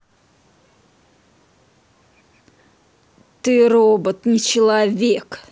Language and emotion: Russian, angry